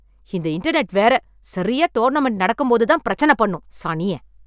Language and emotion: Tamil, angry